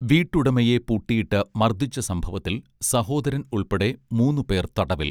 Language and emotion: Malayalam, neutral